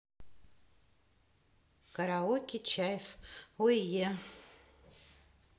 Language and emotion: Russian, neutral